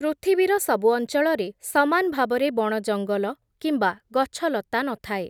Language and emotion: Odia, neutral